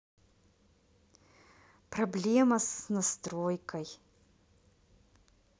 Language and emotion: Russian, neutral